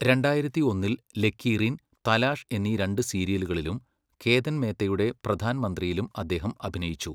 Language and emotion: Malayalam, neutral